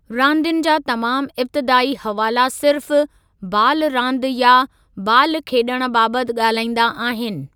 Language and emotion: Sindhi, neutral